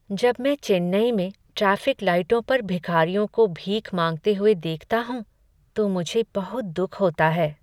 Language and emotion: Hindi, sad